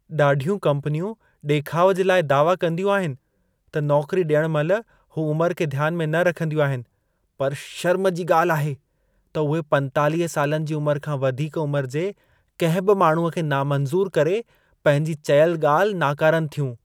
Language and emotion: Sindhi, disgusted